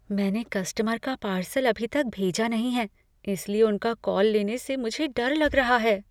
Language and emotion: Hindi, fearful